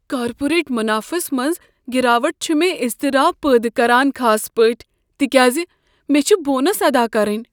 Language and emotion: Kashmiri, fearful